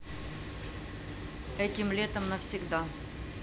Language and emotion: Russian, neutral